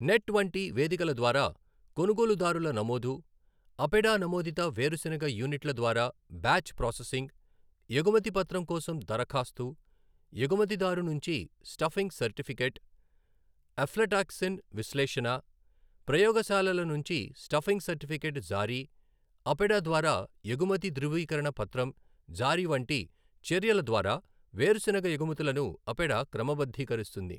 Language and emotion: Telugu, neutral